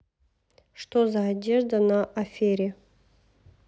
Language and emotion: Russian, neutral